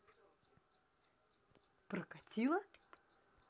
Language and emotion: Russian, positive